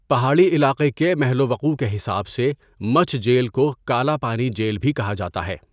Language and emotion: Urdu, neutral